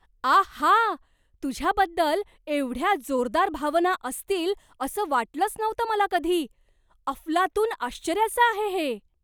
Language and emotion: Marathi, surprised